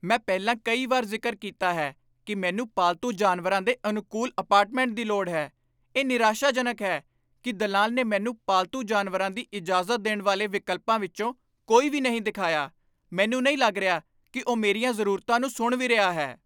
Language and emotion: Punjabi, angry